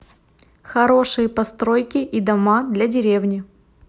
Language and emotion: Russian, neutral